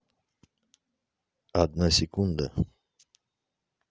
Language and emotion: Russian, neutral